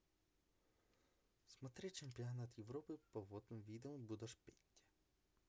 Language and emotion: Russian, neutral